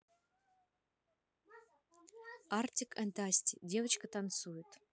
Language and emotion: Russian, neutral